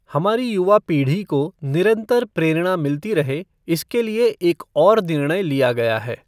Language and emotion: Hindi, neutral